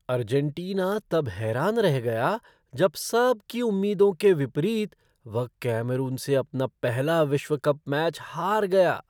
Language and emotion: Hindi, surprised